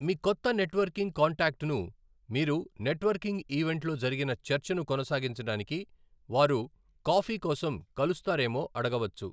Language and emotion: Telugu, neutral